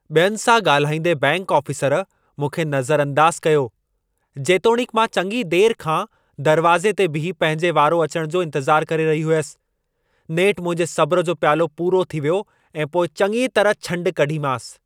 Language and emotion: Sindhi, angry